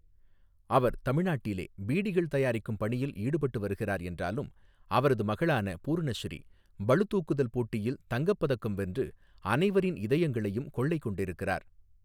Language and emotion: Tamil, neutral